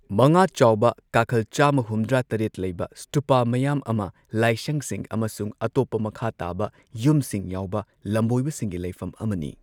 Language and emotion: Manipuri, neutral